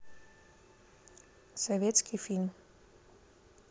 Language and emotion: Russian, neutral